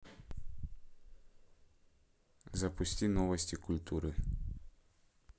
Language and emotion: Russian, neutral